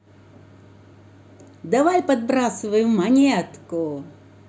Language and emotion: Russian, positive